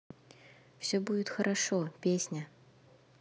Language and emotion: Russian, neutral